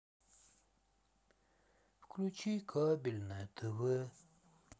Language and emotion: Russian, sad